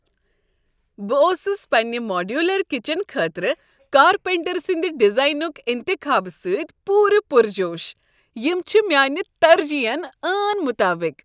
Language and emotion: Kashmiri, happy